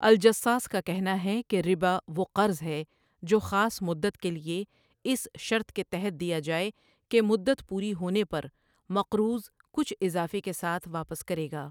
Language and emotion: Urdu, neutral